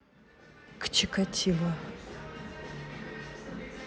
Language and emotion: Russian, neutral